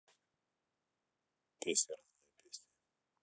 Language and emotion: Russian, neutral